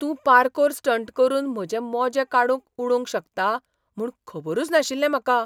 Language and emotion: Goan Konkani, surprised